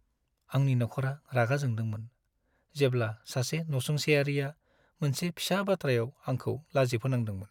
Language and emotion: Bodo, sad